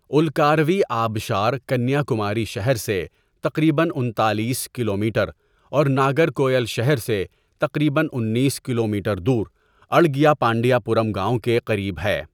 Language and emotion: Urdu, neutral